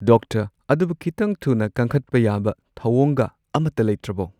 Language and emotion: Manipuri, neutral